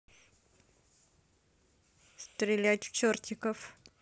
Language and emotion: Russian, neutral